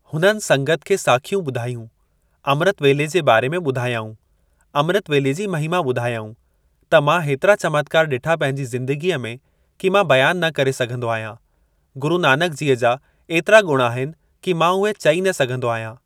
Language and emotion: Sindhi, neutral